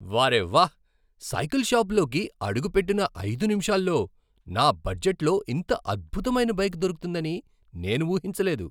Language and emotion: Telugu, surprised